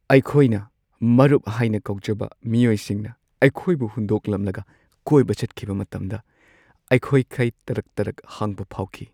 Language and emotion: Manipuri, sad